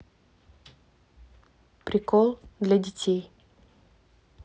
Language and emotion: Russian, neutral